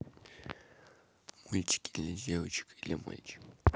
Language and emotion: Russian, neutral